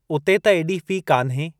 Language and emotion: Sindhi, neutral